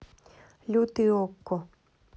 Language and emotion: Russian, neutral